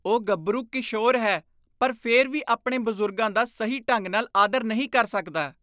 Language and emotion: Punjabi, disgusted